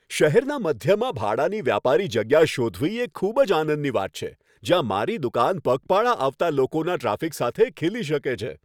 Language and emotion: Gujarati, happy